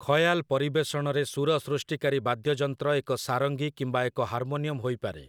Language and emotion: Odia, neutral